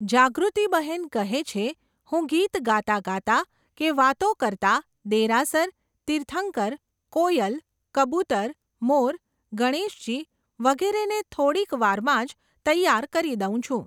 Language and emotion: Gujarati, neutral